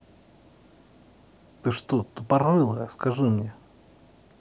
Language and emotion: Russian, angry